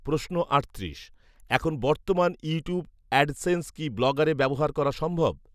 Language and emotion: Bengali, neutral